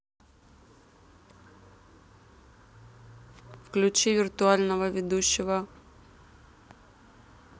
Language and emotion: Russian, neutral